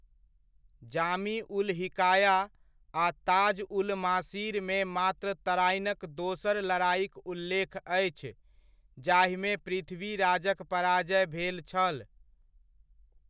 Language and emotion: Maithili, neutral